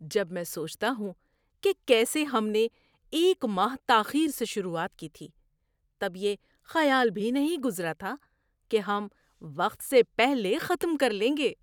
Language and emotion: Urdu, surprised